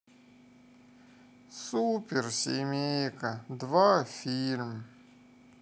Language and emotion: Russian, sad